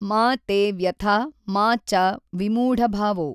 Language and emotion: Kannada, neutral